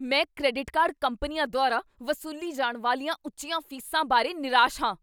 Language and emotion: Punjabi, angry